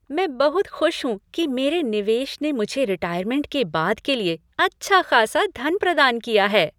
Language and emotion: Hindi, happy